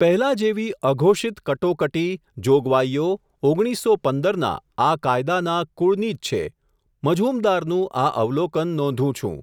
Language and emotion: Gujarati, neutral